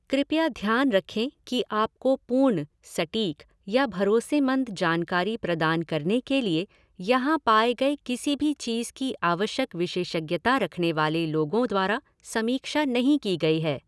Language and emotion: Hindi, neutral